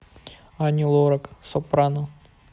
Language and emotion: Russian, neutral